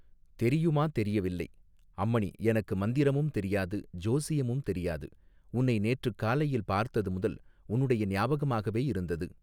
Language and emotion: Tamil, neutral